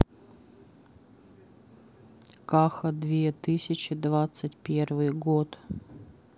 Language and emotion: Russian, sad